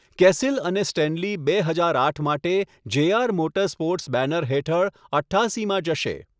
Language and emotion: Gujarati, neutral